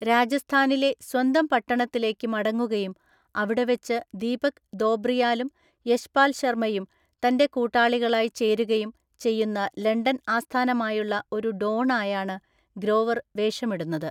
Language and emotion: Malayalam, neutral